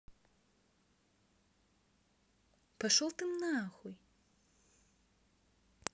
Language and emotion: Russian, angry